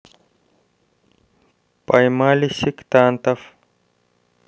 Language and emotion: Russian, neutral